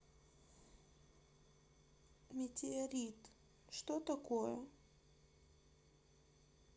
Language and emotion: Russian, sad